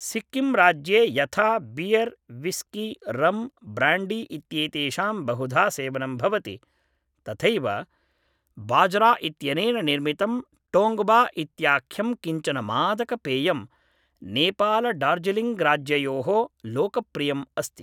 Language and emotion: Sanskrit, neutral